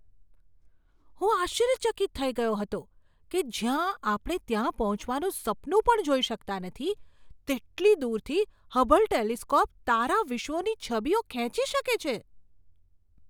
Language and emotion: Gujarati, surprised